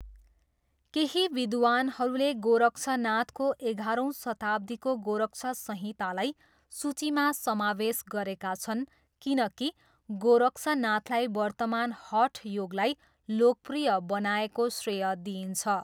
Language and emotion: Nepali, neutral